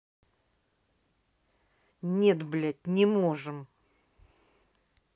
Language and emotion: Russian, angry